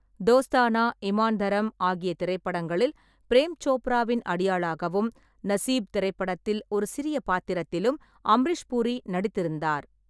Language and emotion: Tamil, neutral